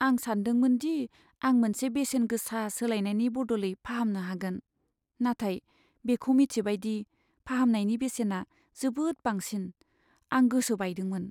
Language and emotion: Bodo, sad